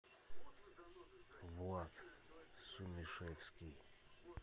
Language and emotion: Russian, neutral